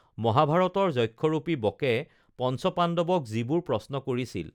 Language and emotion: Assamese, neutral